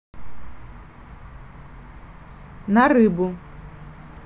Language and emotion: Russian, neutral